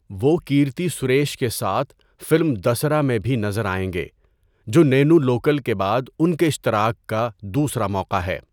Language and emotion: Urdu, neutral